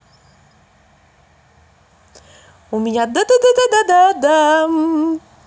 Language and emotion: Russian, positive